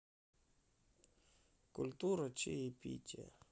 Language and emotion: Russian, sad